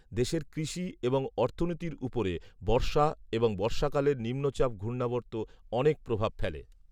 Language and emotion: Bengali, neutral